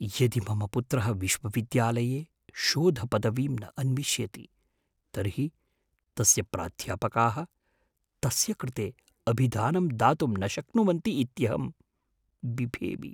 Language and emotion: Sanskrit, fearful